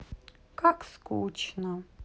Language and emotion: Russian, sad